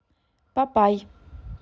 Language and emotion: Russian, neutral